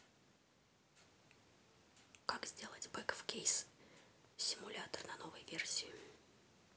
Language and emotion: Russian, neutral